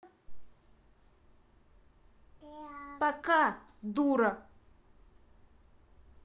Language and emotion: Russian, angry